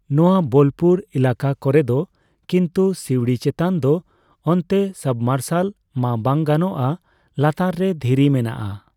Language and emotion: Santali, neutral